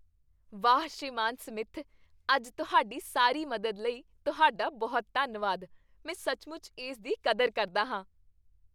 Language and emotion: Punjabi, happy